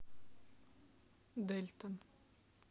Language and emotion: Russian, sad